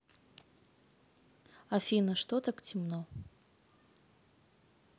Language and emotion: Russian, neutral